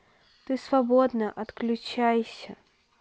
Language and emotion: Russian, neutral